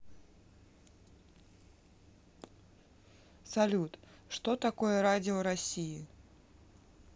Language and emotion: Russian, neutral